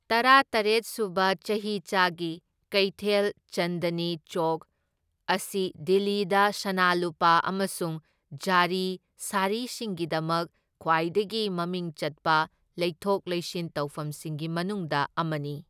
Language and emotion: Manipuri, neutral